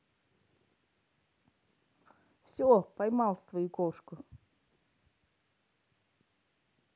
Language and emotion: Russian, neutral